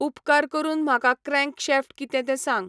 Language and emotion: Goan Konkani, neutral